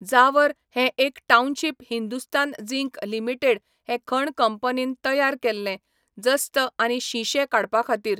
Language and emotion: Goan Konkani, neutral